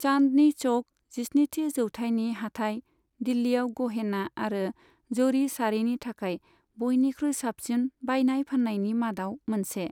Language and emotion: Bodo, neutral